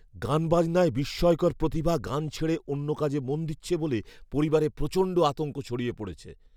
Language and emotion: Bengali, fearful